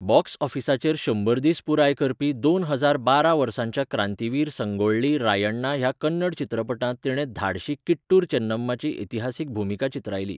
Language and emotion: Goan Konkani, neutral